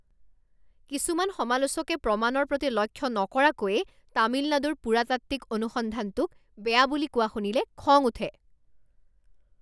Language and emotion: Assamese, angry